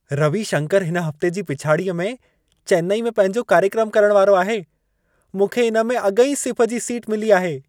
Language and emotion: Sindhi, happy